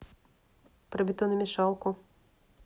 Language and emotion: Russian, neutral